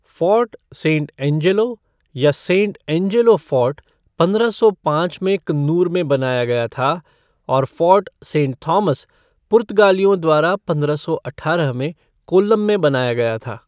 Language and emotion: Hindi, neutral